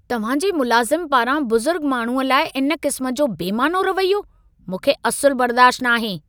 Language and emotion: Sindhi, angry